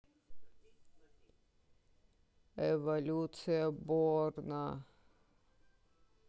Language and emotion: Russian, sad